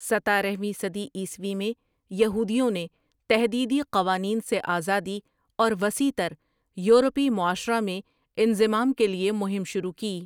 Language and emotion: Urdu, neutral